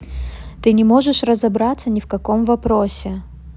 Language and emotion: Russian, neutral